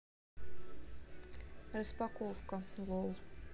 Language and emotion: Russian, neutral